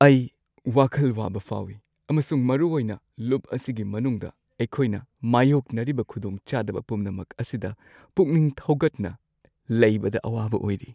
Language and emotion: Manipuri, sad